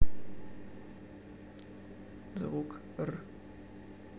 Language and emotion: Russian, neutral